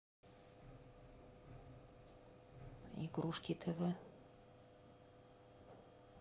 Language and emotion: Russian, neutral